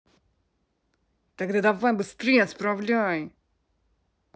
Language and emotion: Russian, angry